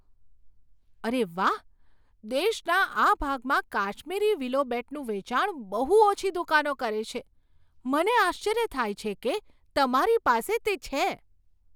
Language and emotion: Gujarati, surprised